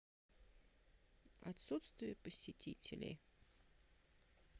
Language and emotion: Russian, sad